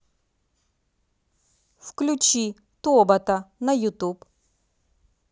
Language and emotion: Russian, neutral